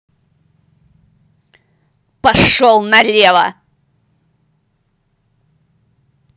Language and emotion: Russian, angry